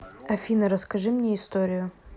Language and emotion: Russian, neutral